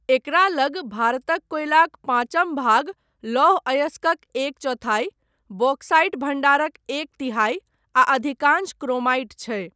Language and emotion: Maithili, neutral